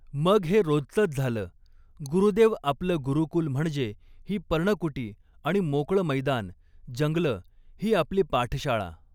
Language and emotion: Marathi, neutral